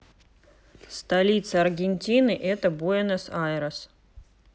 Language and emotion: Russian, neutral